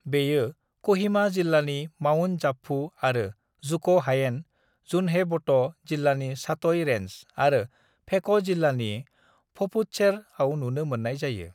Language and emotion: Bodo, neutral